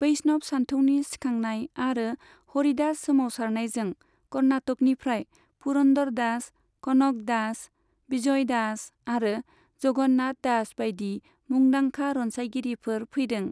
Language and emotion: Bodo, neutral